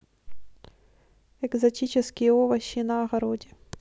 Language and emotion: Russian, neutral